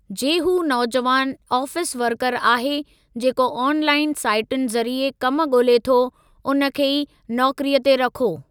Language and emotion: Sindhi, neutral